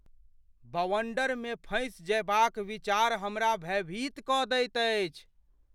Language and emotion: Maithili, fearful